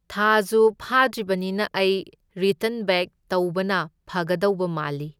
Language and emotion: Manipuri, neutral